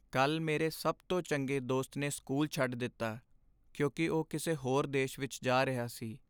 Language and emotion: Punjabi, sad